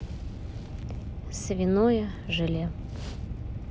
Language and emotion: Russian, neutral